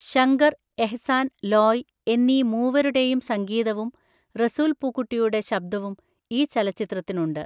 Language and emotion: Malayalam, neutral